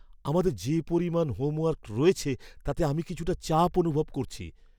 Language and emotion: Bengali, fearful